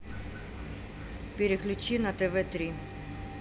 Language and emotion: Russian, neutral